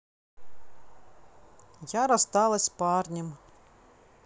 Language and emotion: Russian, sad